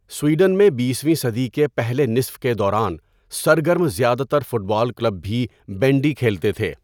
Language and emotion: Urdu, neutral